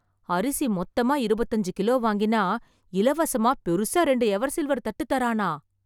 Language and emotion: Tamil, surprised